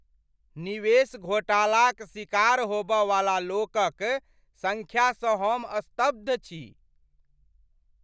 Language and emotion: Maithili, surprised